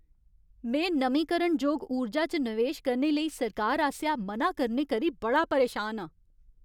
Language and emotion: Dogri, angry